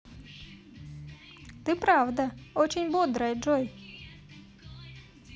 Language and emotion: Russian, positive